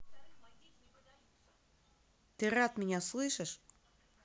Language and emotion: Russian, angry